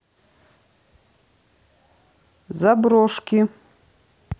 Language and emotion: Russian, neutral